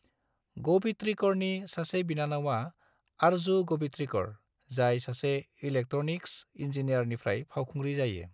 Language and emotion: Bodo, neutral